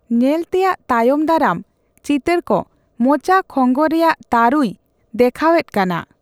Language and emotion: Santali, neutral